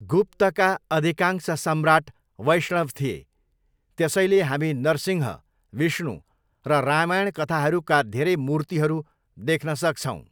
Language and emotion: Nepali, neutral